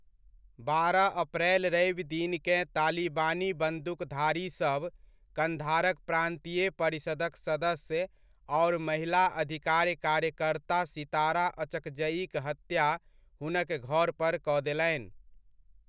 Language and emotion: Maithili, neutral